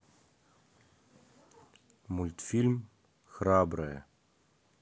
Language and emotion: Russian, neutral